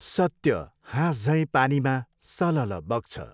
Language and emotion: Nepali, neutral